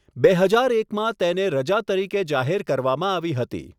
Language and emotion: Gujarati, neutral